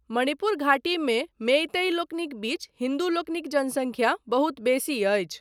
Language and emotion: Maithili, neutral